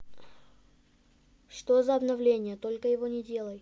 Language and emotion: Russian, neutral